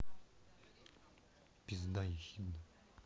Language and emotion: Russian, angry